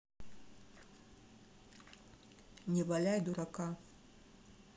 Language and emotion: Russian, neutral